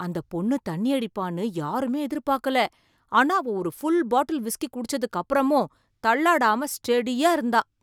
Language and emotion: Tamil, surprised